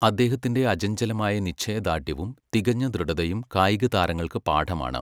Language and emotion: Malayalam, neutral